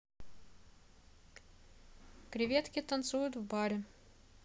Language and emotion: Russian, neutral